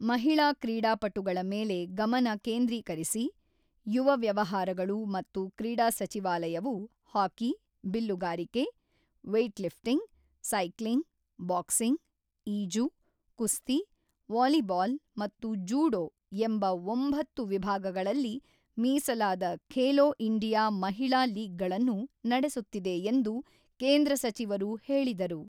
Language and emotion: Kannada, neutral